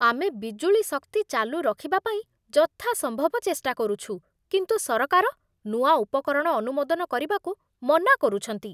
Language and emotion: Odia, disgusted